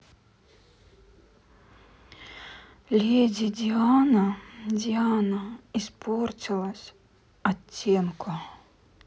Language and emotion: Russian, sad